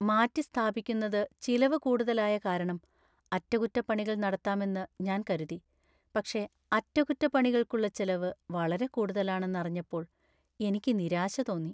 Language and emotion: Malayalam, sad